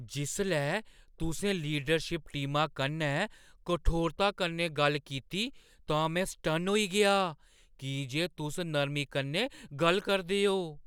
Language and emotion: Dogri, surprised